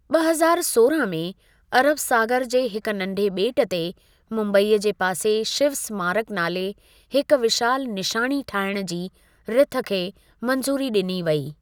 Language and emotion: Sindhi, neutral